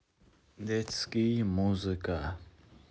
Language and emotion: Russian, neutral